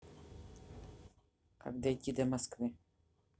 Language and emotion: Russian, neutral